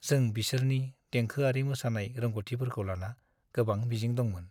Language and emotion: Bodo, sad